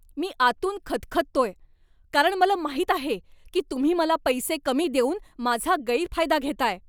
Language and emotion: Marathi, angry